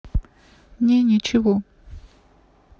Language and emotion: Russian, sad